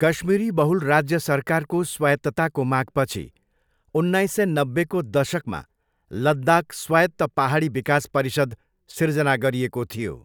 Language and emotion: Nepali, neutral